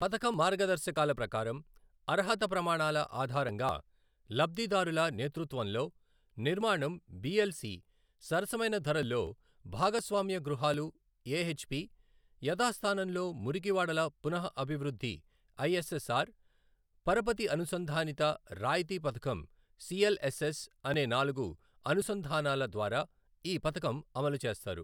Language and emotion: Telugu, neutral